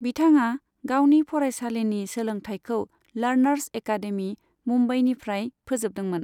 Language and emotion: Bodo, neutral